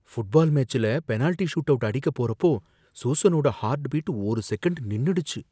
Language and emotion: Tamil, fearful